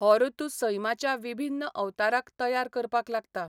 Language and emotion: Goan Konkani, neutral